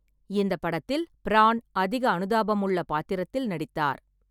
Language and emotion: Tamil, neutral